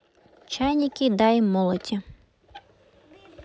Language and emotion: Russian, neutral